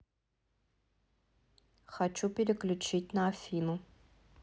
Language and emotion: Russian, neutral